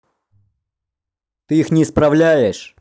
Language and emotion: Russian, angry